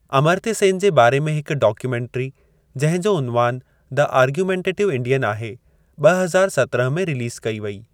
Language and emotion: Sindhi, neutral